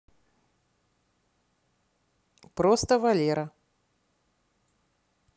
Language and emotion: Russian, neutral